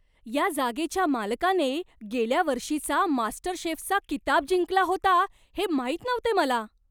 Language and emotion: Marathi, surprised